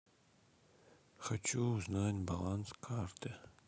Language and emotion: Russian, sad